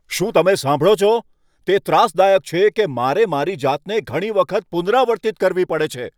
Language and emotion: Gujarati, angry